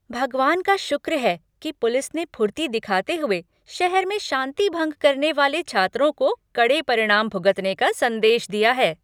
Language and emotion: Hindi, happy